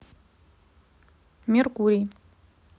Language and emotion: Russian, neutral